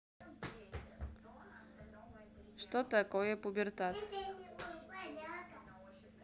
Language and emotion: Russian, neutral